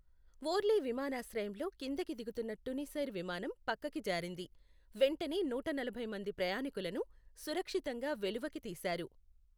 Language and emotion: Telugu, neutral